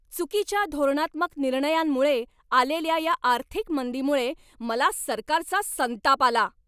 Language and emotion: Marathi, angry